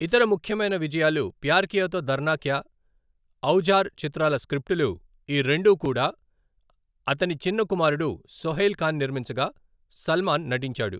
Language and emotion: Telugu, neutral